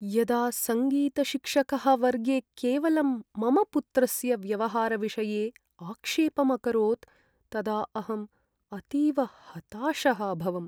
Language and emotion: Sanskrit, sad